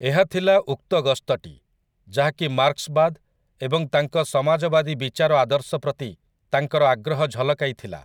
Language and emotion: Odia, neutral